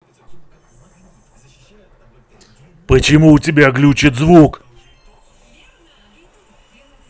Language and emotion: Russian, angry